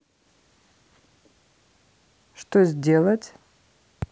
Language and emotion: Russian, neutral